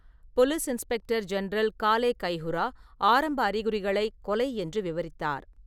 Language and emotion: Tamil, neutral